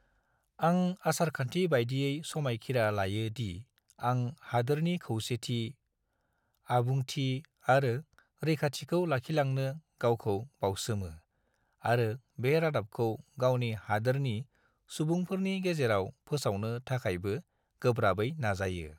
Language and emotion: Bodo, neutral